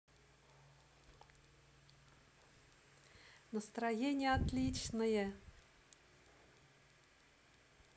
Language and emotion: Russian, positive